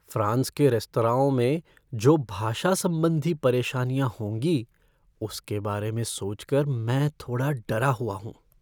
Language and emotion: Hindi, fearful